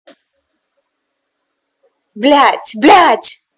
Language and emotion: Russian, angry